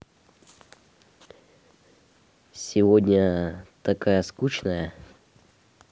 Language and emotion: Russian, neutral